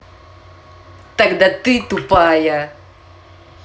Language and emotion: Russian, angry